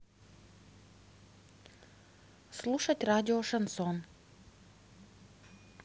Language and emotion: Russian, neutral